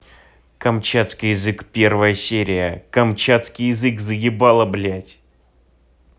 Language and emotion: Russian, angry